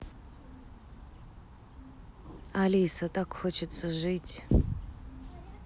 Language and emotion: Russian, sad